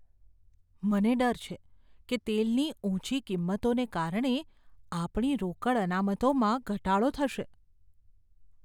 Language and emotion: Gujarati, fearful